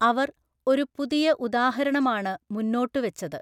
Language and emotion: Malayalam, neutral